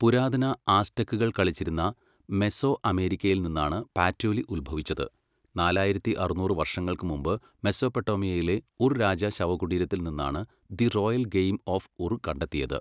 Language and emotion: Malayalam, neutral